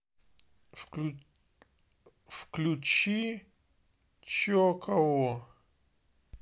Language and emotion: Russian, neutral